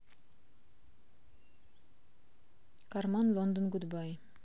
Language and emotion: Russian, neutral